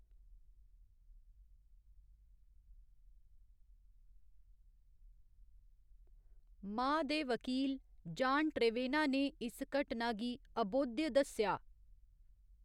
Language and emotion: Dogri, neutral